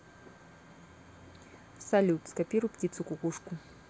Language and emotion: Russian, neutral